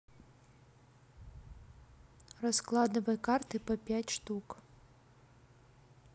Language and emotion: Russian, neutral